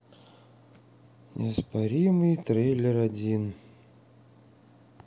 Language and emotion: Russian, sad